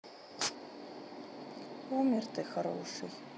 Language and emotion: Russian, sad